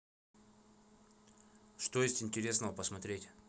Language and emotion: Russian, neutral